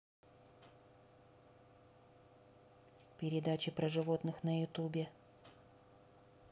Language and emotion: Russian, neutral